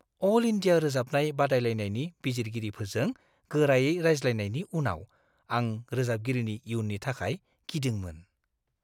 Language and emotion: Bodo, fearful